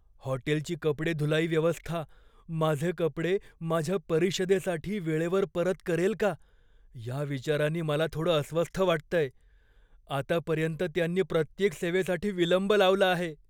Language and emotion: Marathi, fearful